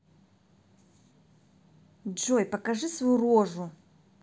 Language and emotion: Russian, angry